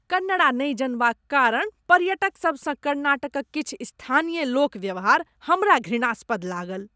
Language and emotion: Maithili, disgusted